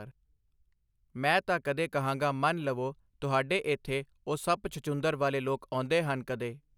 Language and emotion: Punjabi, neutral